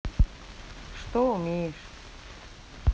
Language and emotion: Russian, neutral